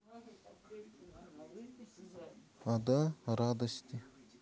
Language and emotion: Russian, neutral